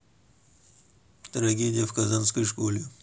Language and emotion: Russian, neutral